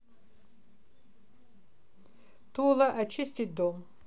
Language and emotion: Russian, neutral